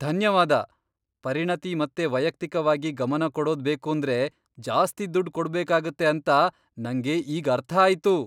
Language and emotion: Kannada, surprised